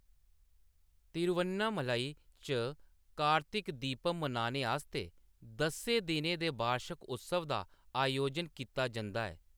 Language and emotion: Dogri, neutral